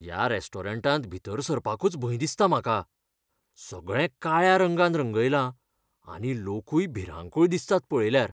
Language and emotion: Goan Konkani, fearful